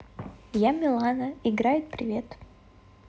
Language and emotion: Russian, positive